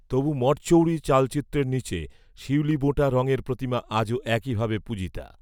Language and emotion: Bengali, neutral